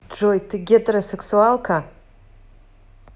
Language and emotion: Russian, neutral